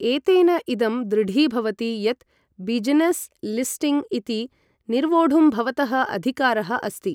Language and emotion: Sanskrit, neutral